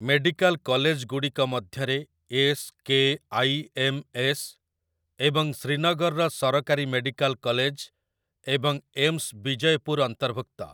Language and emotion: Odia, neutral